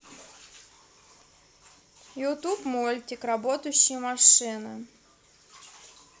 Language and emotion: Russian, neutral